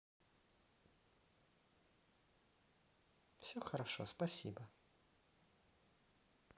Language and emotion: Russian, neutral